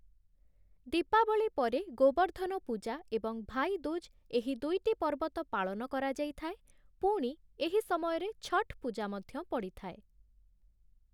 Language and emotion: Odia, neutral